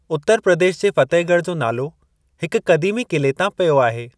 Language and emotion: Sindhi, neutral